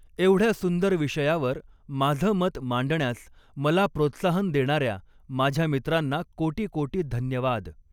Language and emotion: Marathi, neutral